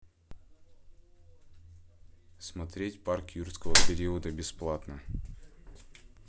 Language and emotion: Russian, neutral